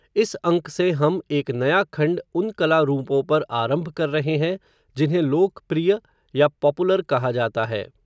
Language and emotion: Hindi, neutral